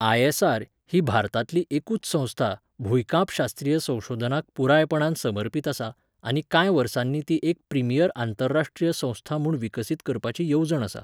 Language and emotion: Goan Konkani, neutral